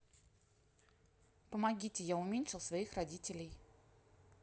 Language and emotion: Russian, neutral